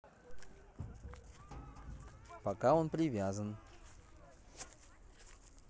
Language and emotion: Russian, neutral